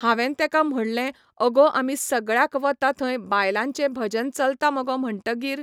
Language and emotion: Goan Konkani, neutral